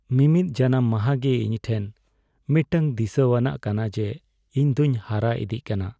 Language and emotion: Santali, sad